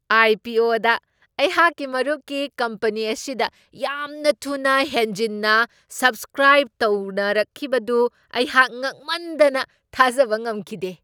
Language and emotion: Manipuri, surprised